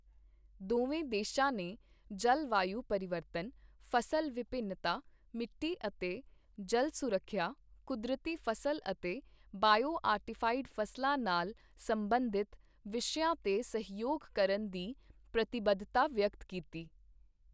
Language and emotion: Punjabi, neutral